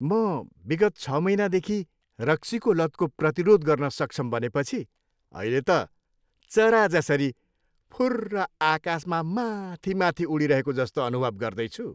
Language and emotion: Nepali, happy